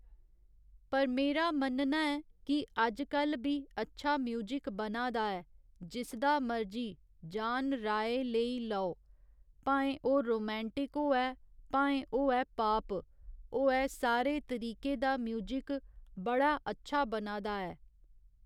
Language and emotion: Dogri, neutral